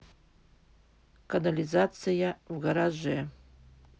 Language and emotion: Russian, neutral